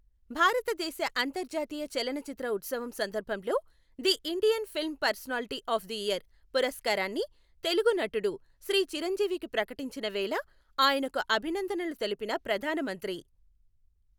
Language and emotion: Telugu, neutral